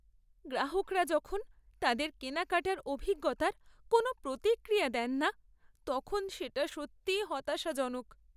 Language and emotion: Bengali, sad